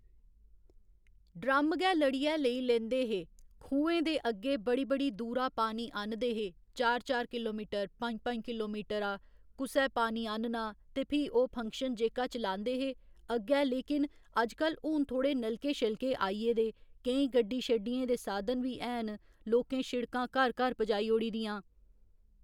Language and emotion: Dogri, neutral